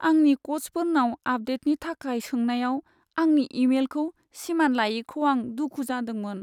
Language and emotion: Bodo, sad